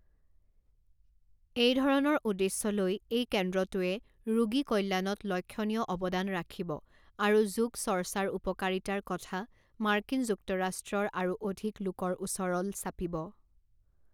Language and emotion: Assamese, neutral